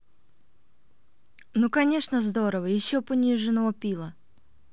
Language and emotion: Russian, neutral